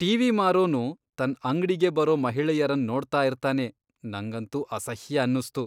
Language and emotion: Kannada, disgusted